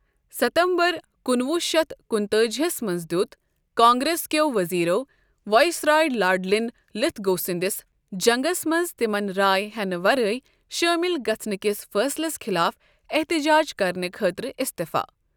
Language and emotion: Kashmiri, neutral